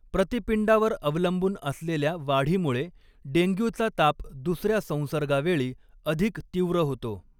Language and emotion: Marathi, neutral